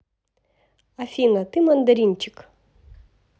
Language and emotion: Russian, positive